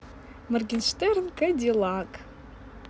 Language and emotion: Russian, positive